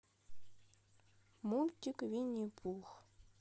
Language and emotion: Russian, sad